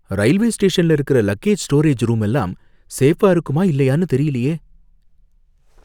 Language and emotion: Tamil, fearful